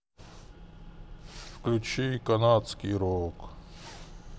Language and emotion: Russian, sad